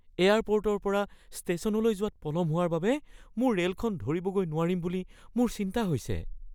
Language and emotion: Assamese, fearful